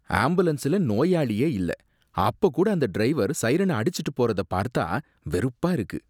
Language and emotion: Tamil, disgusted